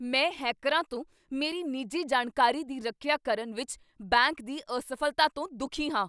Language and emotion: Punjabi, angry